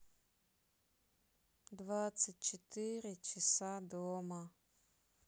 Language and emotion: Russian, sad